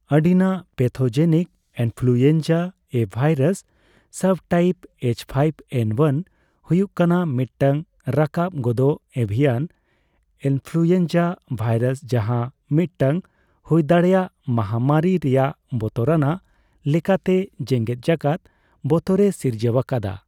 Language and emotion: Santali, neutral